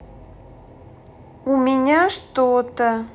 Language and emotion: Russian, neutral